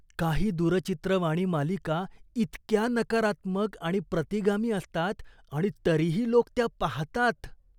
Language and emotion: Marathi, disgusted